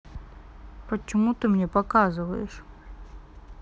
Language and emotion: Russian, sad